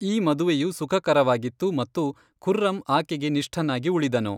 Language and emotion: Kannada, neutral